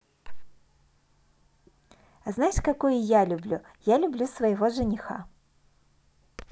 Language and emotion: Russian, positive